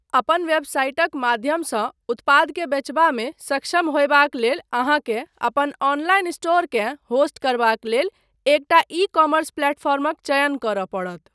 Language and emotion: Maithili, neutral